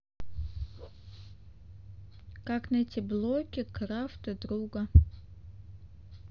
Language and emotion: Russian, neutral